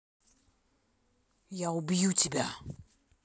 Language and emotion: Russian, angry